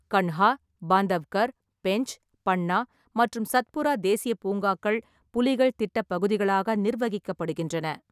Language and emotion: Tamil, neutral